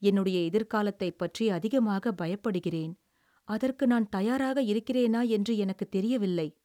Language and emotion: Tamil, sad